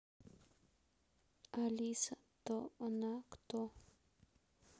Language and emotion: Russian, sad